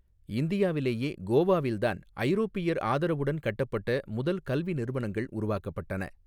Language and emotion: Tamil, neutral